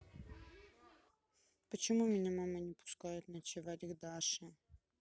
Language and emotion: Russian, sad